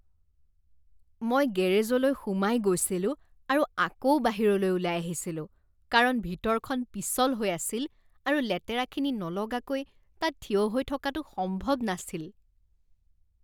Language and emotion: Assamese, disgusted